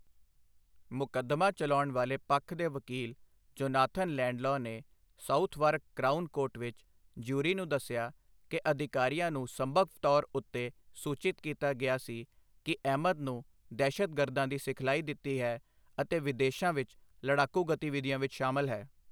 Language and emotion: Punjabi, neutral